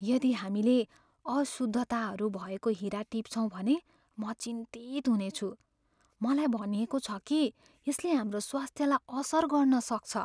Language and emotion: Nepali, fearful